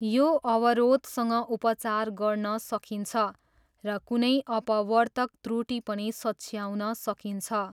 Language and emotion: Nepali, neutral